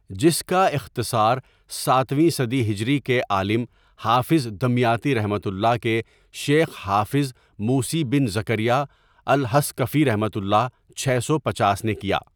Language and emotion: Urdu, neutral